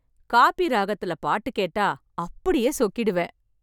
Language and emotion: Tamil, happy